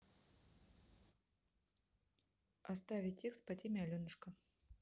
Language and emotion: Russian, neutral